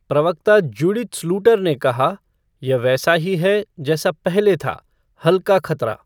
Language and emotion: Hindi, neutral